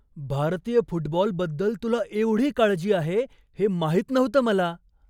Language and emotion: Marathi, surprised